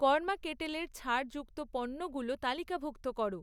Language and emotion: Bengali, neutral